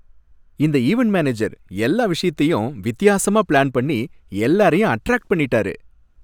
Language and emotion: Tamil, happy